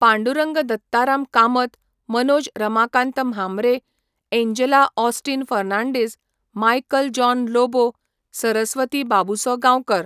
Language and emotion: Goan Konkani, neutral